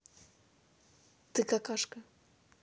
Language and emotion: Russian, neutral